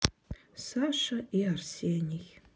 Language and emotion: Russian, sad